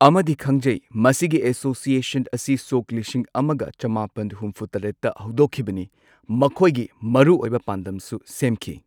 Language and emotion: Manipuri, neutral